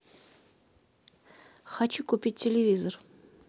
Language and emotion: Russian, neutral